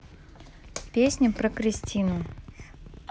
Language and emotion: Russian, neutral